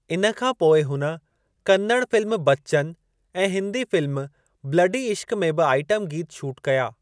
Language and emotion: Sindhi, neutral